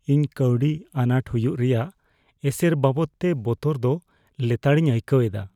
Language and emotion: Santali, fearful